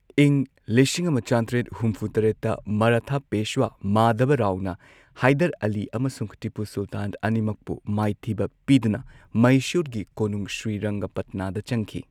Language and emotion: Manipuri, neutral